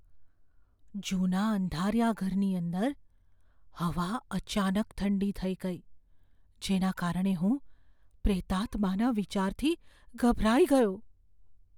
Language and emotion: Gujarati, fearful